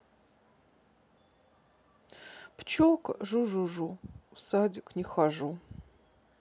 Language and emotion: Russian, sad